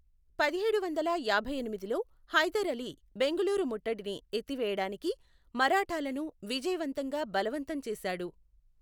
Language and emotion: Telugu, neutral